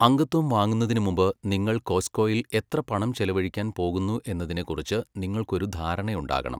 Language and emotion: Malayalam, neutral